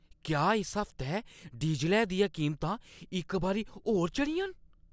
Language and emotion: Dogri, surprised